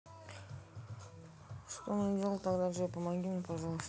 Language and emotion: Russian, neutral